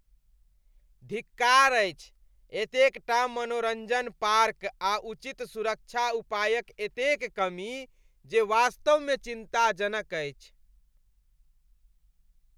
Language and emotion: Maithili, disgusted